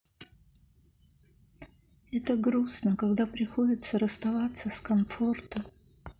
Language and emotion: Russian, sad